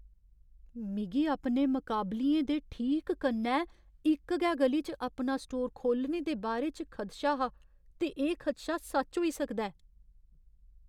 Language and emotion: Dogri, fearful